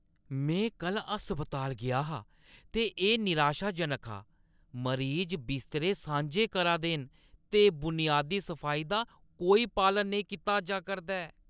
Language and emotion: Dogri, disgusted